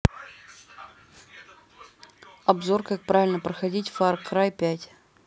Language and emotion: Russian, neutral